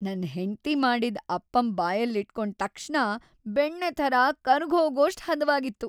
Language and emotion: Kannada, happy